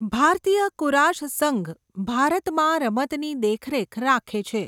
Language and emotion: Gujarati, neutral